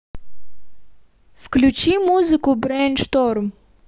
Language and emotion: Russian, neutral